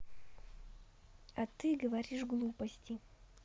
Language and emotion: Russian, neutral